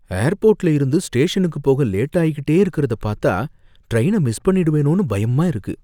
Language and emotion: Tamil, fearful